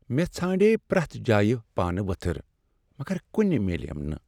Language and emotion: Kashmiri, sad